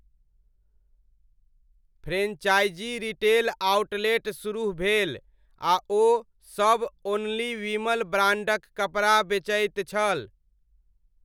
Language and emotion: Maithili, neutral